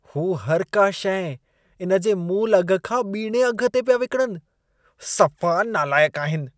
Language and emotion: Sindhi, disgusted